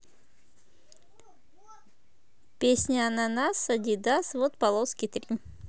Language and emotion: Russian, positive